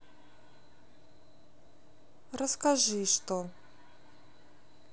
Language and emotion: Russian, sad